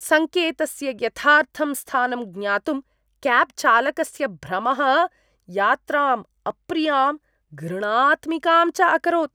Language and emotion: Sanskrit, disgusted